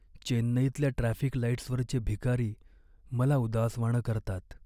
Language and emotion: Marathi, sad